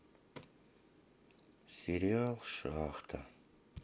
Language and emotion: Russian, sad